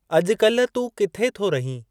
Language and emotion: Sindhi, neutral